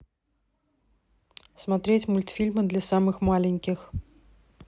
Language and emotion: Russian, neutral